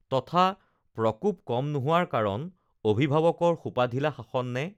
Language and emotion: Assamese, neutral